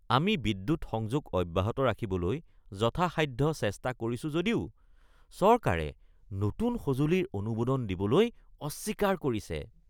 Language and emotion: Assamese, disgusted